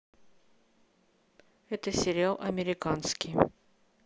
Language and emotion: Russian, neutral